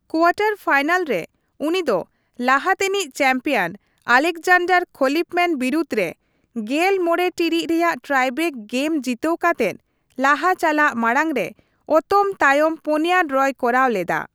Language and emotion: Santali, neutral